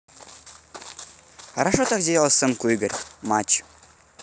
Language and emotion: Russian, positive